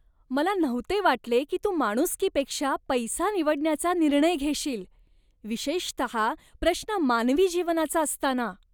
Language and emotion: Marathi, disgusted